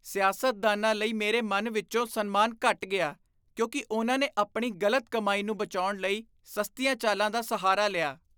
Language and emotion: Punjabi, disgusted